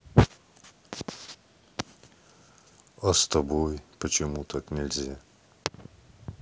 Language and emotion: Russian, neutral